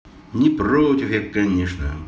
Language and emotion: Russian, positive